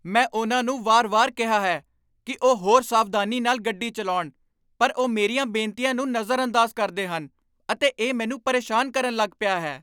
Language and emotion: Punjabi, angry